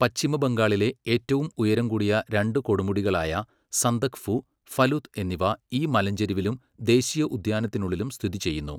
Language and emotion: Malayalam, neutral